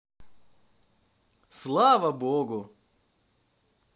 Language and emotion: Russian, positive